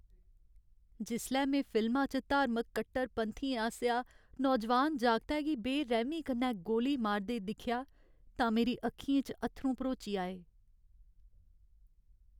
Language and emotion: Dogri, sad